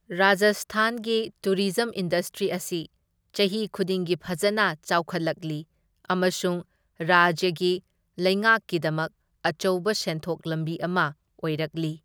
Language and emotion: Manipuri, neutral